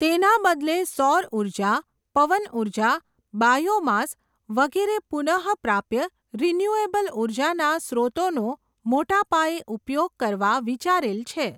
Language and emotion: Gujarati, neutral